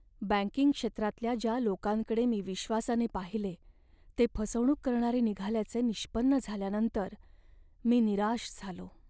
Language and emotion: Marathi, sad